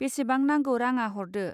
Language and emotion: Bodo, neutral